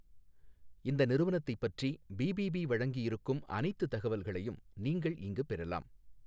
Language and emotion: Tamil, neutral